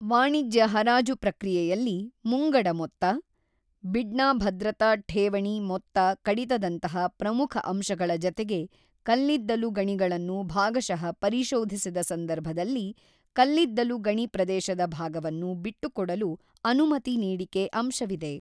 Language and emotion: Kannada, neutral